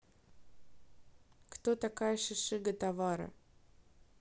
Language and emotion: Russian, neutral